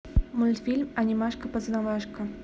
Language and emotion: Russian, neutral